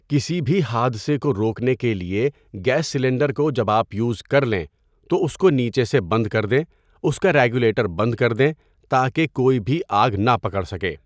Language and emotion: Urdu, neutral